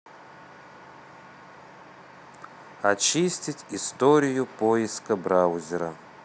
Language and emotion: Russian, neutral